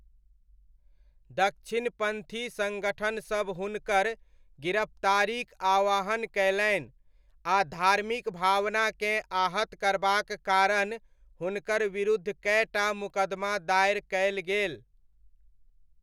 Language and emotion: Maithili, neutral